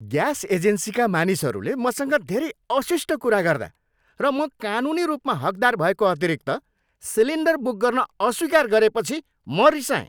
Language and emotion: Nepali, angry